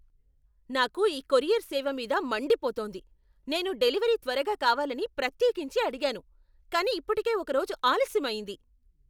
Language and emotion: Telugu, angry